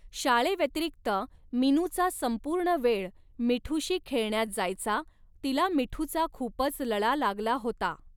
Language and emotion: Marathi, neutral